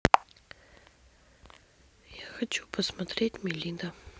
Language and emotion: Russian, neutral